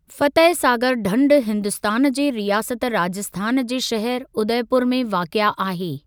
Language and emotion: Sindhi, neutral